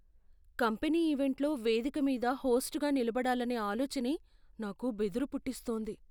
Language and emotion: Telugu, fearful